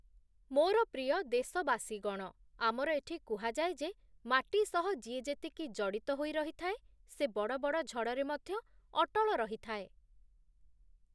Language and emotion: Odia, neutral